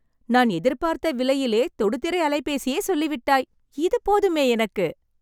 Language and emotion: Tamil, happy